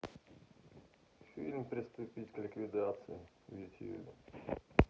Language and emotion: Russian, neutral